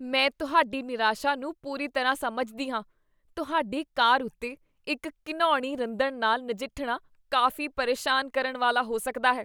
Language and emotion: Punjabi, disgusted